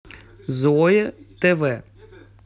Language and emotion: Russian, neutral